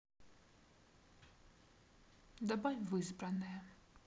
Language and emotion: Russian, neutral